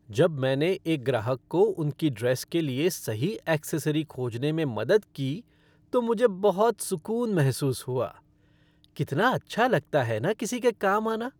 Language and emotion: Hindi, happy